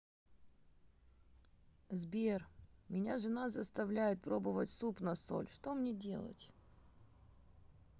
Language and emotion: Russian, sad